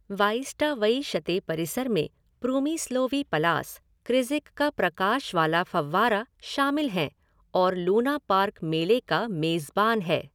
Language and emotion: Hindi, neutral